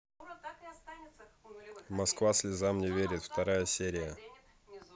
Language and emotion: Russian, neutral